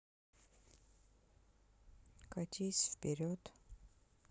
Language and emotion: Russian, neutral